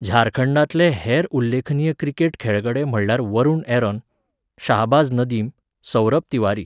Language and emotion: Goan Konkani, neutral